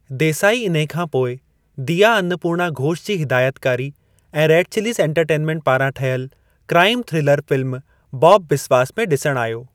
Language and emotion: Sindhi, neutral